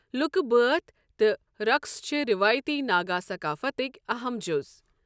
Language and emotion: Kashmiri, neutral